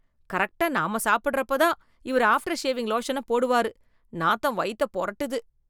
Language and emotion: Tamil, disgusted